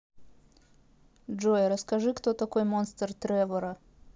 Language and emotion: Russian, neutral